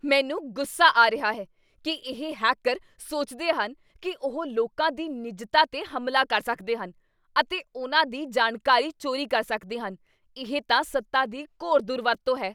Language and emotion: Punjabi, angry